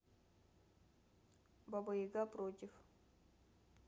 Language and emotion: Russian, neutral